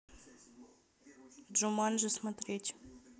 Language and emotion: Russian, neutral